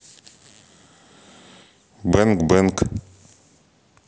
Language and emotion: Russian, neutral